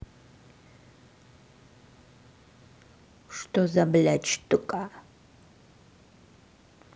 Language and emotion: Russian, angry